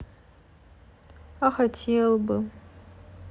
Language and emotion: Russian, sad